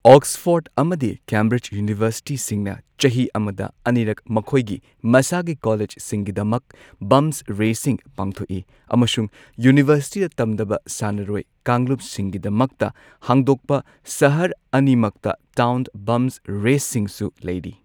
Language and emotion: Manipuri, neutral